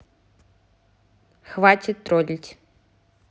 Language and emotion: Russian, angry